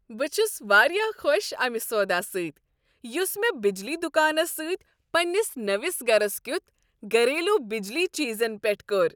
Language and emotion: Kashmiri, happy